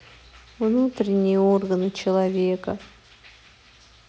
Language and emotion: Russian, sad